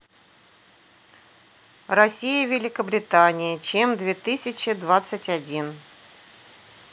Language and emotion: Russian, neutral